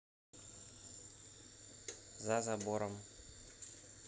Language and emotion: Russian, neutral